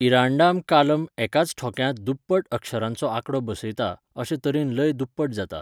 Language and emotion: Goan Konkani, neutral